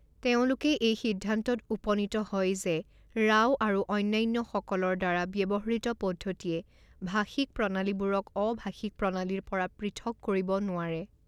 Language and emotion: Assamese, neutral